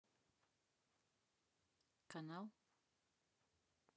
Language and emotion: Russian, neutral